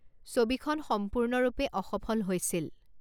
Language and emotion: Assamese, neutral